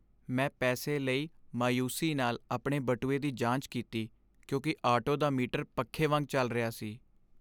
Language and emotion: Punjabi, sad